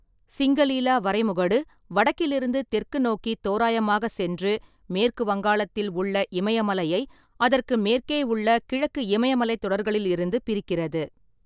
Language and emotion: Tamil, neutral